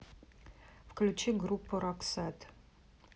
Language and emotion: Russian, neutral